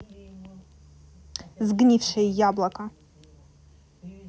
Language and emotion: Russian, angry